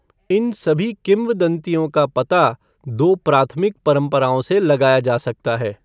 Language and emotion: Hindi, neutral